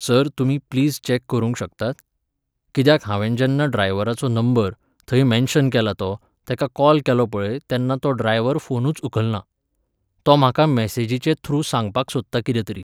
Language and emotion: Goan Konkani, neutral